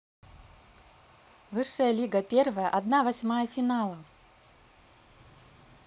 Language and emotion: Russian, positive